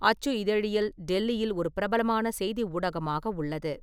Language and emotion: Tamil, neutral